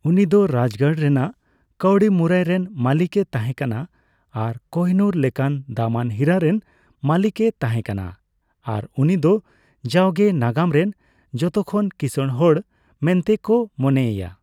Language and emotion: Santali, neutral